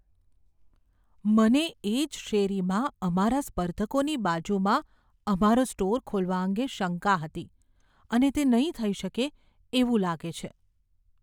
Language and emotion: Gujarati, fearful